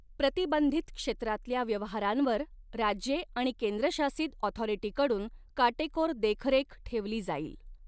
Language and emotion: Marathi, neutral